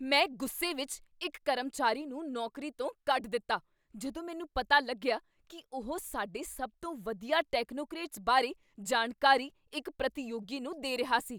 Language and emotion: Punjabi, angry